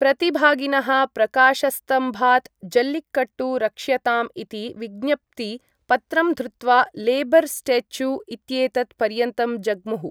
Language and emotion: Sanskrit, neutral